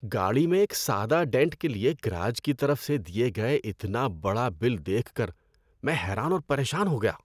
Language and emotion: Urdu, disgusted